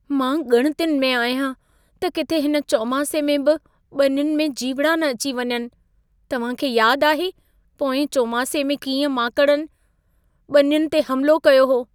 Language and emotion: Sindhi, fearful